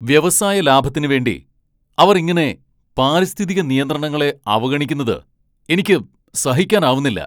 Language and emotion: Malayalam, angry